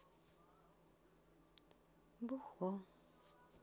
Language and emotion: Russian, sad